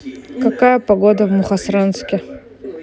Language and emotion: Russian, neutral